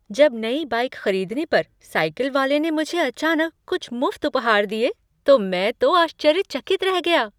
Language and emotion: Hindi, surprised